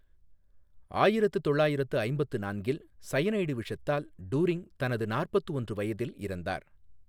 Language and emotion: Tamil, neutral